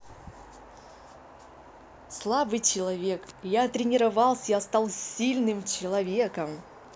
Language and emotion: Russian, positive